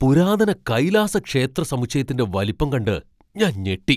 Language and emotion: Malayalam, surprised